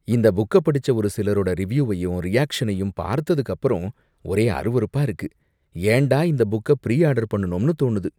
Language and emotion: Tamil, disgusted